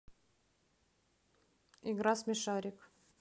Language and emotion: Russian, neutral